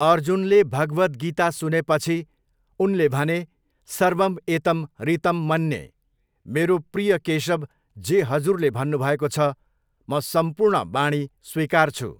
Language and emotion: Nepali, neutral